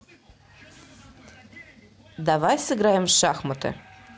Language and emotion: Russian, neutral